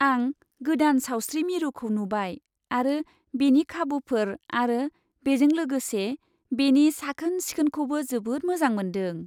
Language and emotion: Bodo, happy